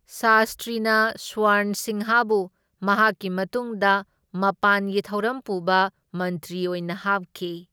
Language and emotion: Manipuri, neutral